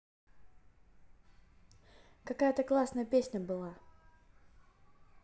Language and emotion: Russian, positive